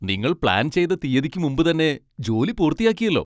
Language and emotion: Malayalam, happy